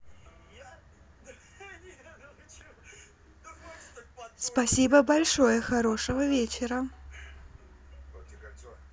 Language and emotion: Russian, positive